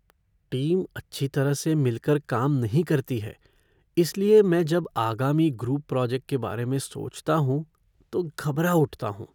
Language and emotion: Hindi, fearful